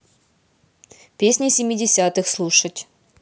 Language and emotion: Russian, neutral